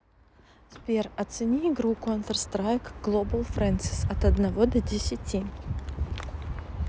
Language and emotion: Russian, neutral